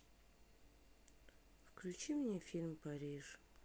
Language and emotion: Russian, sad